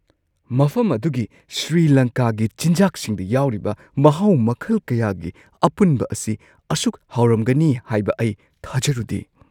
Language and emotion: Manipuri, surprised